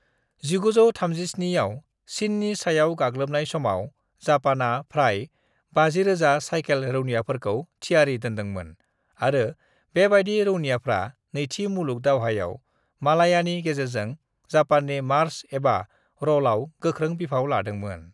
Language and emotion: Bodo, neutral